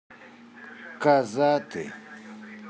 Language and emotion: Russian, neutral